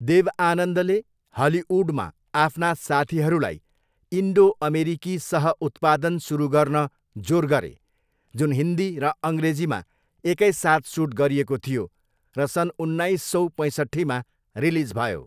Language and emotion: Nepali, neutral